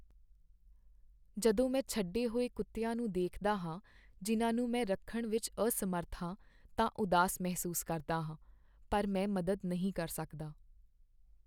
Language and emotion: Punjabi, sad